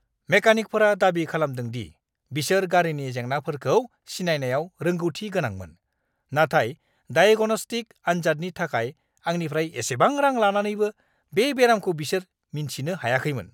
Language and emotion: Bodo, angry